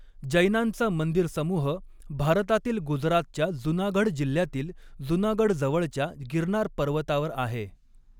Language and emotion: Marathi, neutral